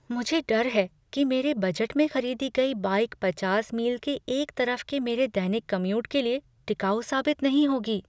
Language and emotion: Hindi, fearful